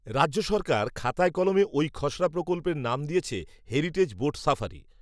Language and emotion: Bengali, neutral